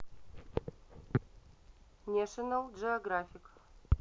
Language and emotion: Russian, neutral